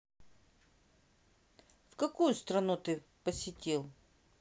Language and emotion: Russian, neutral